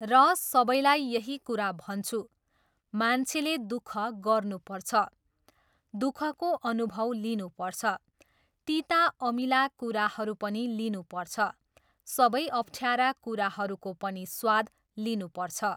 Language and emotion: Nepali, neutral